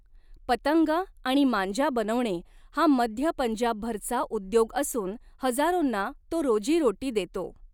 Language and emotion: Marathi, neutral